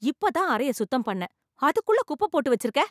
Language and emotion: Tamil, angry